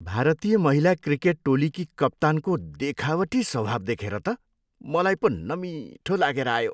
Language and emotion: Nepali, disgusted